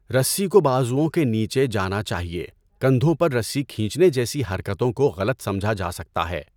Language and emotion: Urdu, neutral